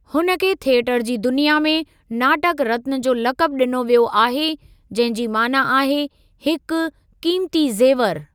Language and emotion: Sindhi, neutral